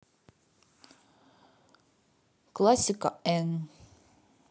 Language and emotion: Russian, neutral